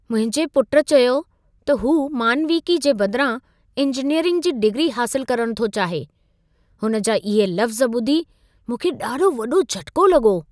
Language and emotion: Sindhi, surprised